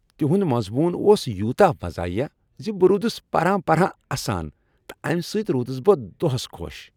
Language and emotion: Kashmiri, happy